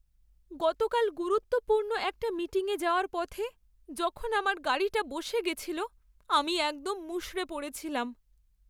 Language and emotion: Bengali, sad